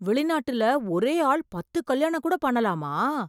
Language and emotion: Tamil, surprised